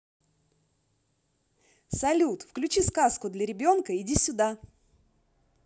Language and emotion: Russian, positive